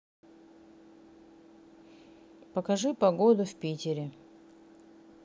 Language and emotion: Russian, neutral